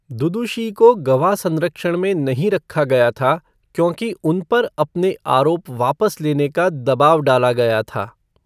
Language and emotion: Hindi, neutral